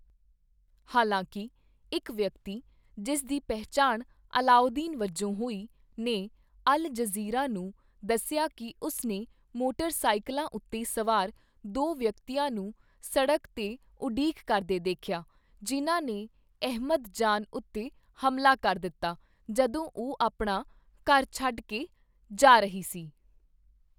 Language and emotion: Punjabi, neutral